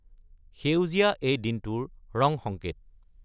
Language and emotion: Assamese, neutral